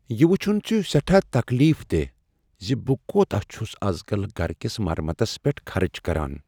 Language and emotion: Kashmiri, sad